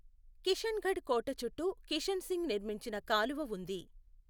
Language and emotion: Telugu, neutral